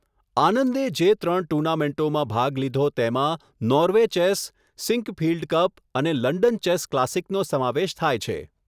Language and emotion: Gujarati, neutral